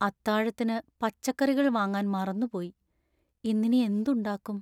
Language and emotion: Malayalam, sad